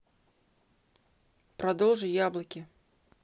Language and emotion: Russian, neutral